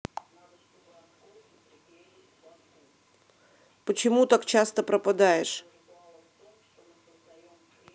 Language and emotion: Russian, angry